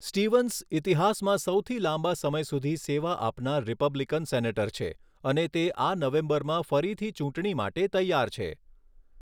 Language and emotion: Gujarati, neutral